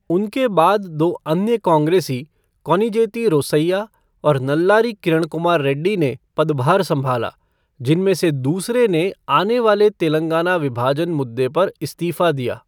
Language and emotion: Hindi, neutral